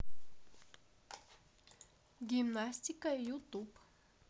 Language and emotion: Russian, neutral